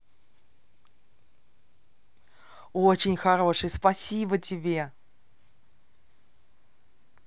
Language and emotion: Russian, positive